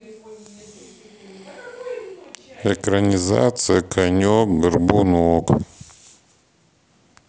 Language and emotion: Russian, neutral